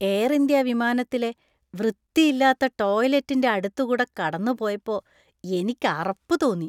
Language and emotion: Malayalam, disgusted